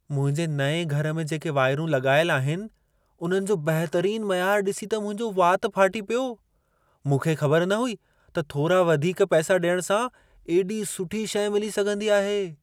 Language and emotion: Sindhi, surprised